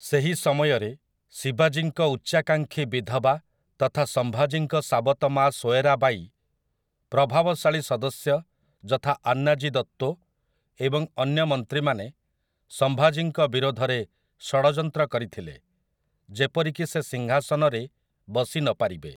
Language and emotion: Odia, neutral